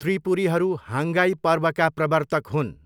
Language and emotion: Nepali, neutral